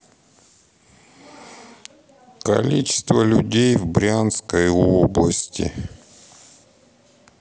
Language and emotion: Russian, sad